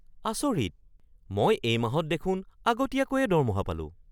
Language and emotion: Assamese, surprised